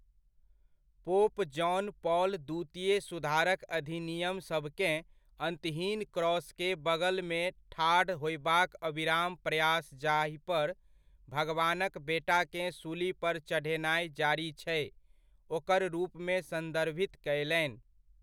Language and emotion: Maithili, neutral